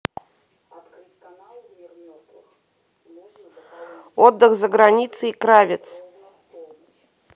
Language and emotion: Russian, neutral